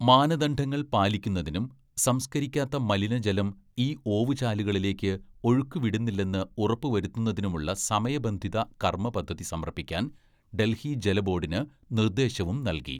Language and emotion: Malayalam, neutral